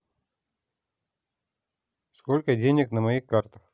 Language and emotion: Russian, neutral